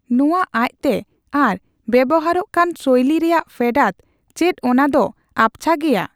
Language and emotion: Santali, neutral